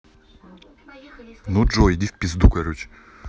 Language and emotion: Russian, angry